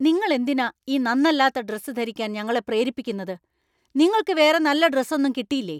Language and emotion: Malayalam, angry